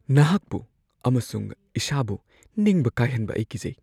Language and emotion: Manipuri, fearful